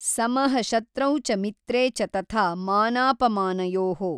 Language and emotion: Kannada, neutral